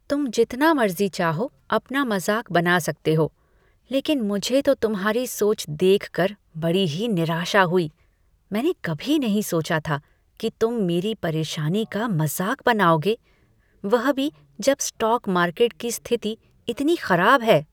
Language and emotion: Hindi, disgusted